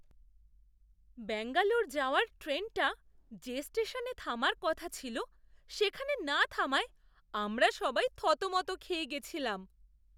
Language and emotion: Bengali, surprised